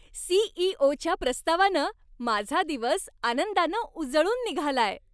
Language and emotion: Marathi, happy